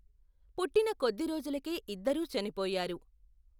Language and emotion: Telugu, neutral